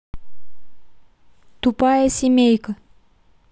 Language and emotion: Russian, neutral